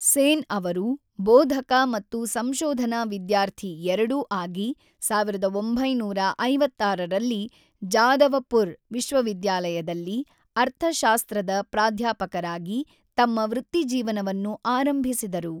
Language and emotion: Kannada, neutral